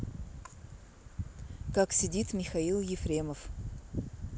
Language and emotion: Russian, neutral